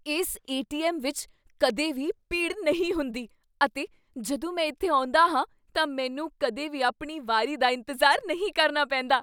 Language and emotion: Punjabi, surprised